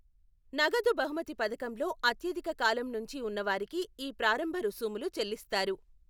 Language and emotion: Telugu, neutral